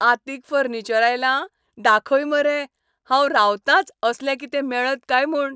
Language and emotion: Goan Konkani, happy